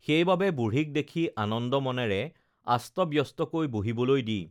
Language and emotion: Assamese, neutral